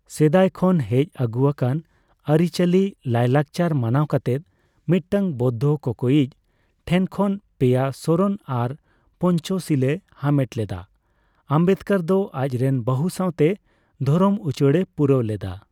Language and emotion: Santali, neutral